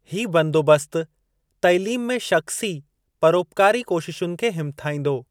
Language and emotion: Sindhi, neutral